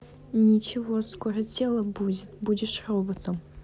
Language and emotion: Russian, neutral